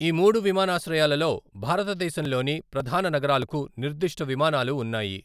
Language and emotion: Telugu, neutral